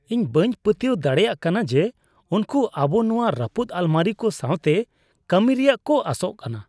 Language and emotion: Santali, disgusted